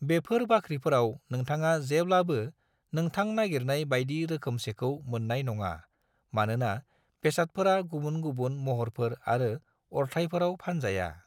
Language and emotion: Bodo, neutral